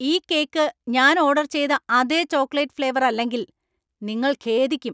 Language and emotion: Malayalam, angry